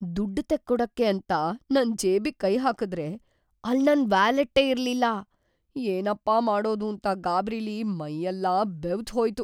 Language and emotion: Kannada, fearful